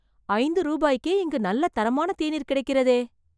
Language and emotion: Tamil, surprised